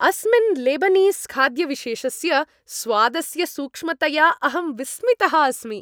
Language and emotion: Sanskrit, happy